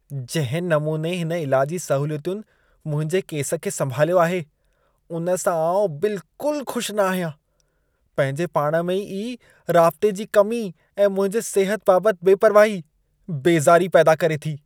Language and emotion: Sindhi, disgusted